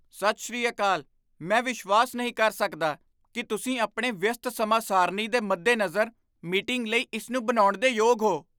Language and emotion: Punjabi, surprised